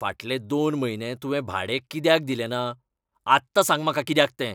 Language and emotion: Goan Konkani, angry